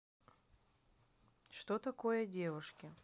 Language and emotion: Russian, neutral